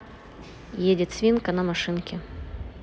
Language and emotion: Russian, neutral